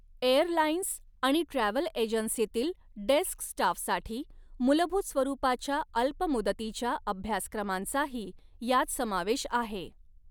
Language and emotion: Marathi, neutral